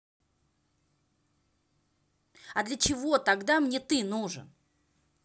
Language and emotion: Russian, angry